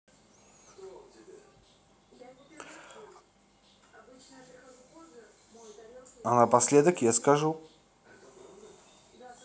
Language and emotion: Russian, neutral